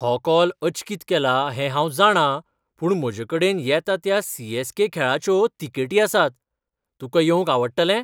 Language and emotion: Goan Konkani, surprised